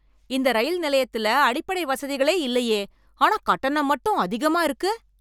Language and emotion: Tamil, angry